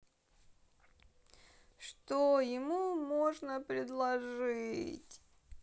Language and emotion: Russian, sad